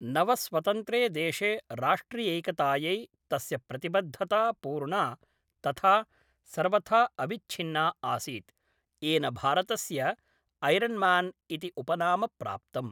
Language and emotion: Sanskrit, neutral